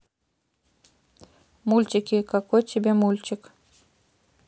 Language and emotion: Russian, neutral